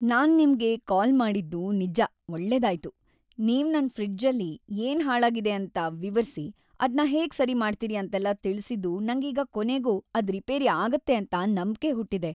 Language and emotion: Kannada, happy